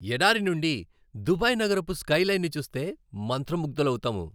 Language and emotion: Telugu, happy